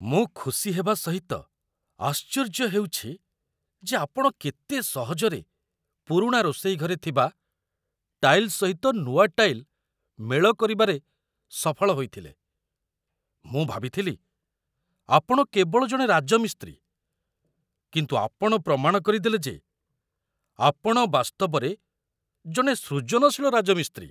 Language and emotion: Odia, surprised